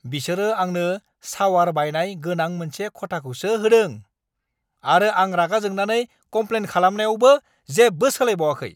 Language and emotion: Bodo, angry